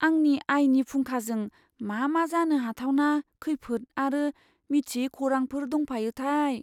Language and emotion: Bodo, fearful